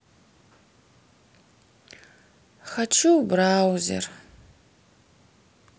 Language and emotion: Russian, sad